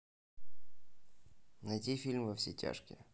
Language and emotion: Russian, neutral